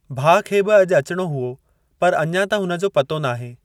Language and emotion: Sindhi, neutral